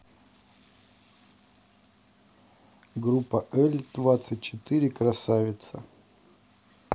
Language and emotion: Russian, neutral